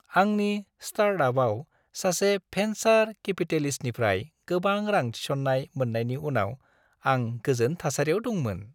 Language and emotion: Bodo, happy